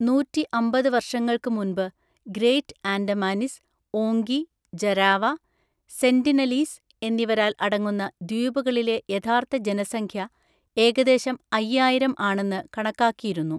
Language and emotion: Malayalam, neutral